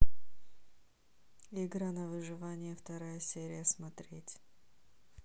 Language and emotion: Russian, neutral